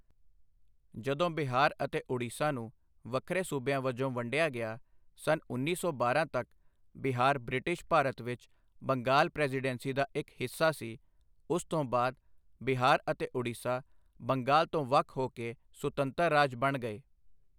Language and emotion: Punjabi, neutral